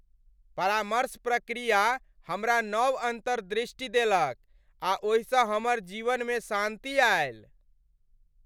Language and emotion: Maithili, happy